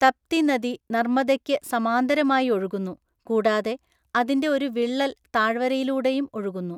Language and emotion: Malayalam, neutral